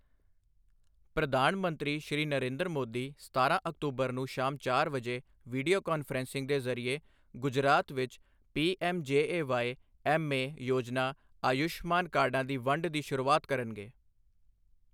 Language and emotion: Punjabi, neutral